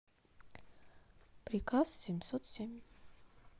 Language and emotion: Russian, neutral